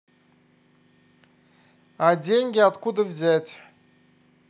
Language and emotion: Russian, neutral